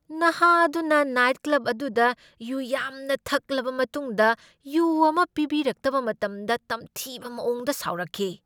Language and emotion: Manipuri, angry